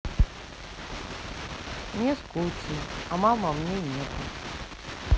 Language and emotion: Russian, sad